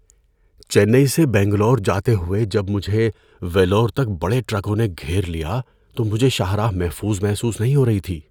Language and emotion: Urdu, fearful